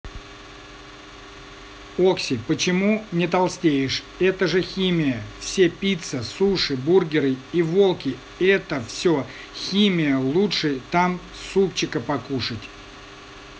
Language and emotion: Russian, neutral